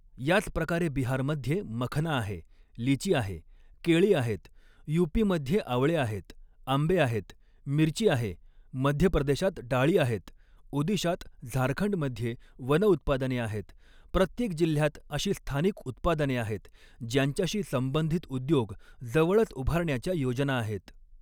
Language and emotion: Marathi, neutral